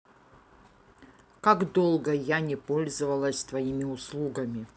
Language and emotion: Russian, neutral